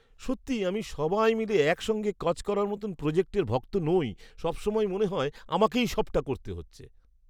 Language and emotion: Bengali, disgusted